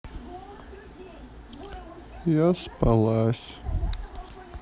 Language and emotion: Russian, neutral